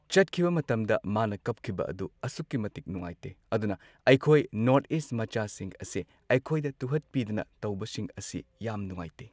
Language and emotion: Manipuri, neutral